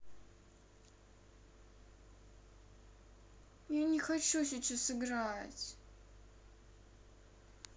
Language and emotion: Russian, sad